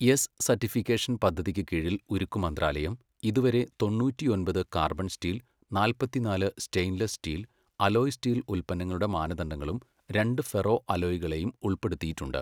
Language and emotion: Malayalam, neutral